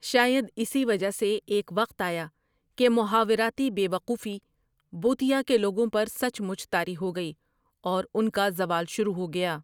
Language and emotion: Urdu, neutral